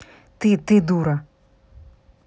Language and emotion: Russian, angry